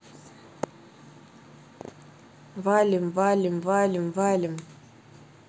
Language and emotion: Russian, neutral